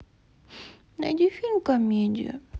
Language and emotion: Russian, sad